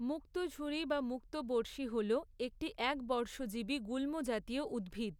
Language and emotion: Bengali, neutral